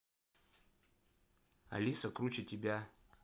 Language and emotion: Russian, neutral